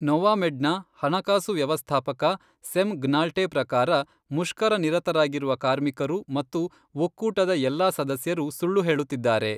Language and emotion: Kannada, neutral